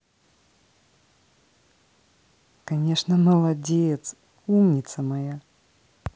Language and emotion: Russian, positive